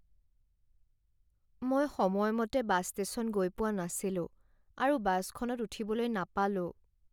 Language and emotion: Assamese, sad